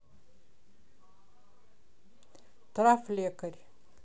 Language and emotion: Russian, neutral